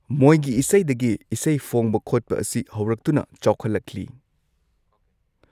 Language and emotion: Manipuri, neutral